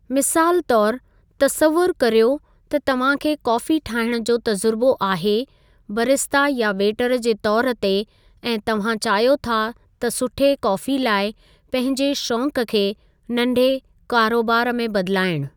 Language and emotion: Sindhi, neutral